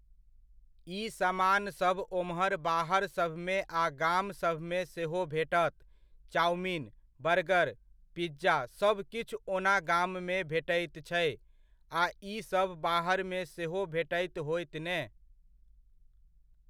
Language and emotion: Maithili, neutral